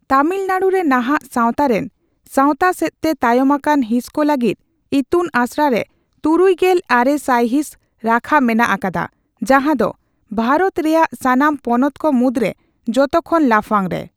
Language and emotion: Santali, neutral